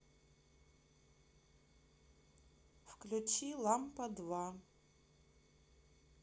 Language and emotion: Russian, neutral